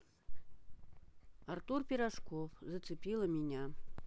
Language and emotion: Russian, neutral